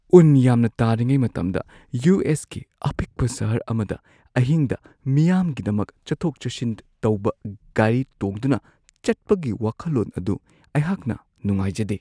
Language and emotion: Manipuri, fearful